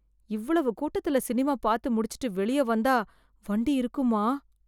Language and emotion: Tamil, fearful